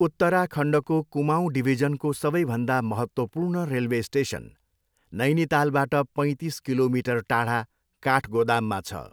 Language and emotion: Nepali, neutral